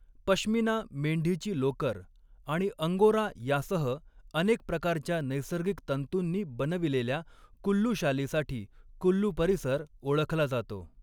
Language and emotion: Marathi, neutral